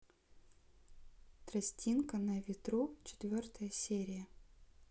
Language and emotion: Russian, neutral